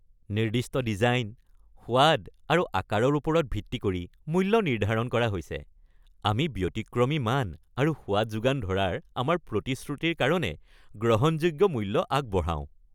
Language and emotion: Assamese, happy